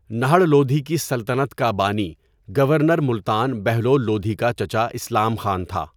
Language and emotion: Urdu, neutral